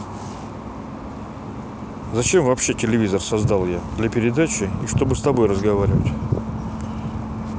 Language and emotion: Russian, neutral